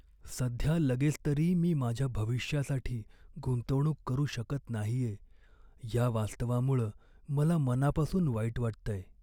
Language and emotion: Marathi, sad